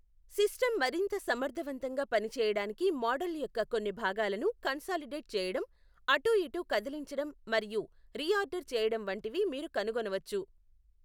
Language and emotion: Telugu, neutral